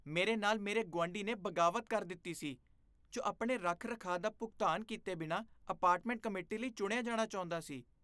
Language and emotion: Punjabi, disgusted